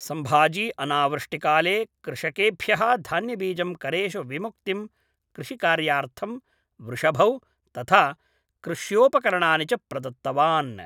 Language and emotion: Sanskrit, neutral